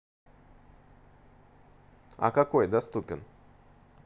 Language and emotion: Russian, neutral